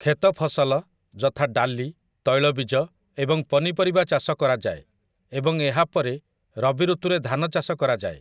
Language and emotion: Odia, neutral